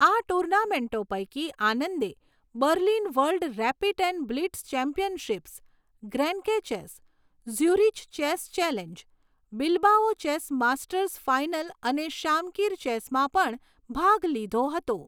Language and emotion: Gujarati, neutral